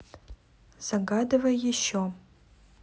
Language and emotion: Russian, neutral